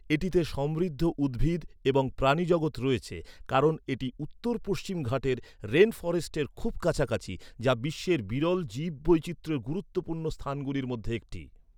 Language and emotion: Bengali, neutral